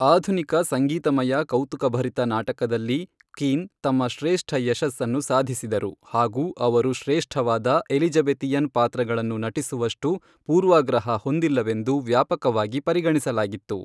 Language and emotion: Kannada, neutral